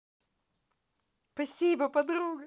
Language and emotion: Russian, positive